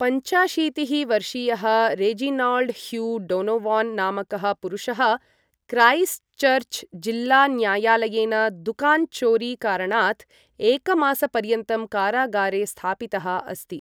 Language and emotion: Sanskrit, neutral